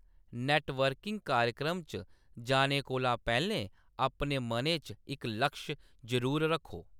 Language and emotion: Dogri, neutral